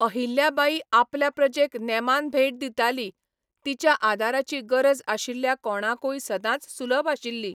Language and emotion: Goan Konkani, neutral